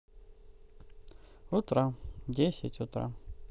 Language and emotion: Russian, neutral